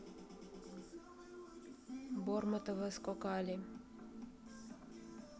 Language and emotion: Russian, neutral